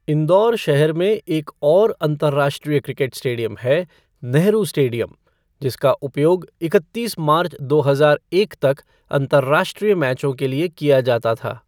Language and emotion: Hindi, neutral